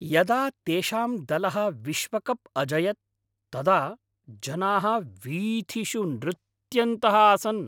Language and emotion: Sanskrit, happy